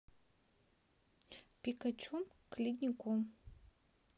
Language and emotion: Russian, neutral